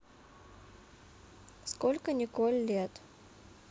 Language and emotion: Russian, neutral